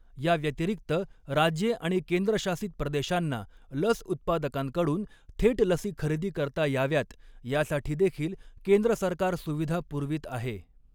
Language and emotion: Marathi, neutral